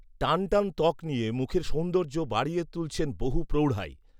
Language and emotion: Bengali, neutral